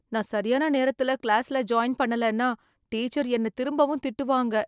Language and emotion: Tamil, fearful